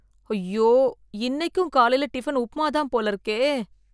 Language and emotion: Tamil, fearful